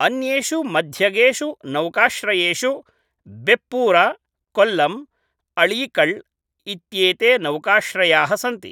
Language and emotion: Sanskrit, neutral